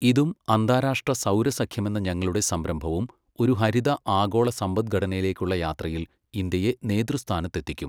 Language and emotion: Malayalam, neutral